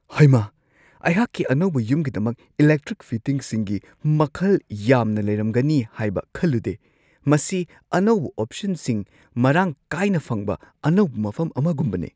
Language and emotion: Manipuri, surprised